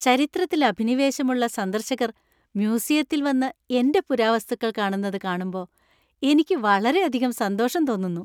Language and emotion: Malayalam, happy